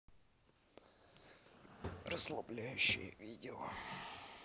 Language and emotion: Russian, neutral